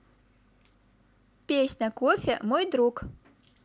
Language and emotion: Russian, positive